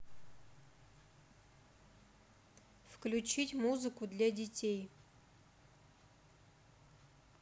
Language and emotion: Russian, neutral